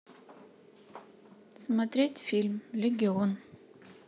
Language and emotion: Russian, neutral